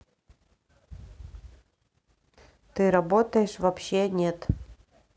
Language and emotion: Russian, neutral